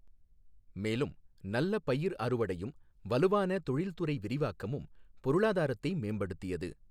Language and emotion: Tamil, neutral